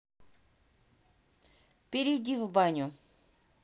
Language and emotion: Russian, neutral